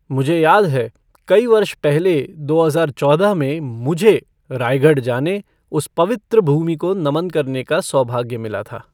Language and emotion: Hindi, neutral